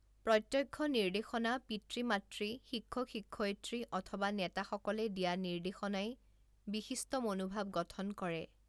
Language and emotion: Assamese, neutral